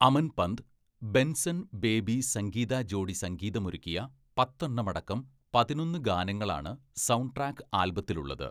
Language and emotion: Malayalam, neutral